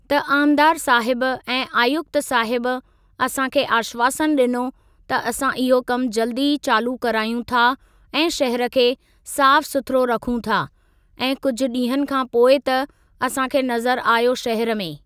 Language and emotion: Sindhi, neutral